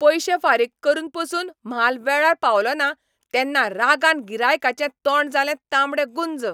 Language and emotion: Goan Konkani, angry